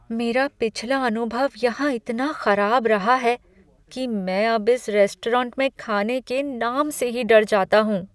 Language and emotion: Hindi, fearful